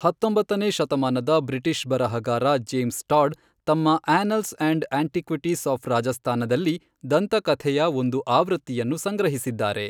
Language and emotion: Kannada, neutral